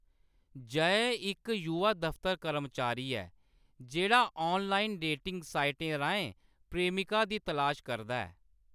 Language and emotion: Dogri, neutral